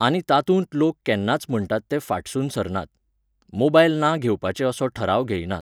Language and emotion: Goan Konkani, neutral